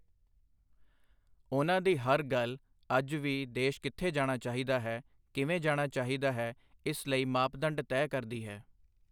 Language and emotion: Punjabi, neutral